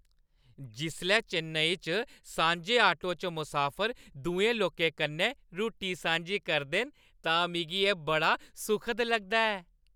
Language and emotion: Dogri, happy